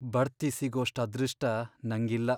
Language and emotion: Kannada, sad